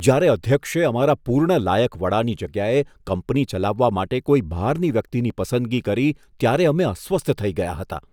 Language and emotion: Gujarati, disgusted